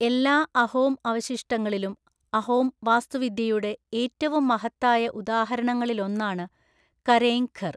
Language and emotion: Malayalam, neutral